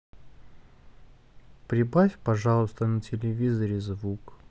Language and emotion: Russian, sad